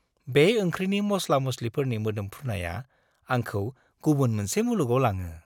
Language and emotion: Bodo, happy